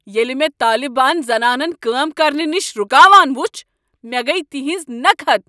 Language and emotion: Kashmiri, angry